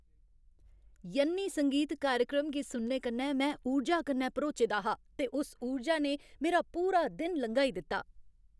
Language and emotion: Dogri, happy